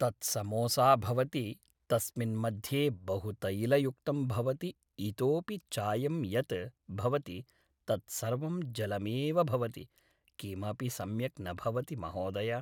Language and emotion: Sanskrit, neutral